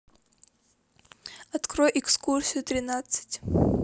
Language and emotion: Russian, neutral